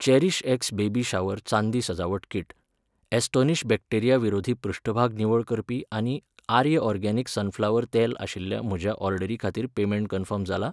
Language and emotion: Goan Konkani, neutral